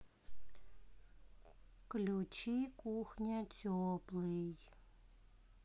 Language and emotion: Russian, sad